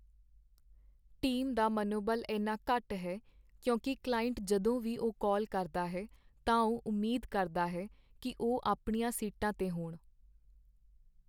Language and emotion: Punjabi, sad